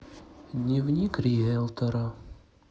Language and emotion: Russian, sad